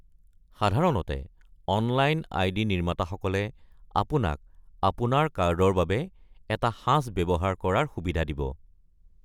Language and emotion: Assamese, neutral